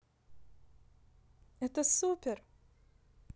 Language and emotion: Russian, positive